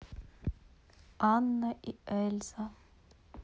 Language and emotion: Russian, neutral